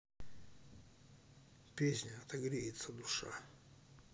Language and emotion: Russian, neutral